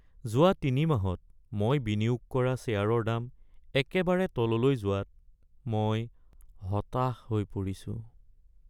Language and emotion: Assamese, sad